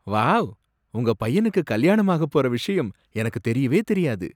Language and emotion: Tamil, surprised